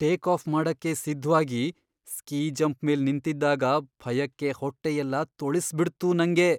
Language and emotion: Kannada, fearful